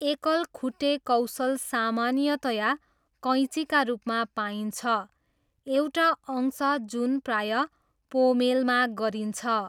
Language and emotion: Nepali, neutral